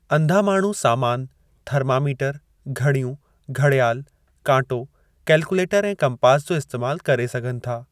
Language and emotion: Sindhi, neutral